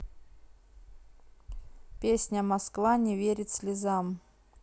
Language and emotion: Russian, neutral